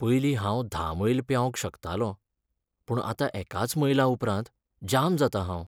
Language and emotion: Goan Konkani, sad